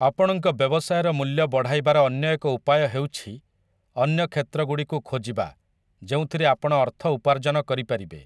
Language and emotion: Odia, neutral